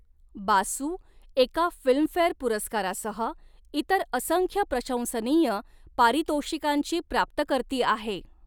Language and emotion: Marathi, neutral